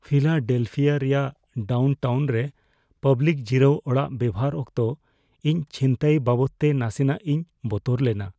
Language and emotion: Santali, fearful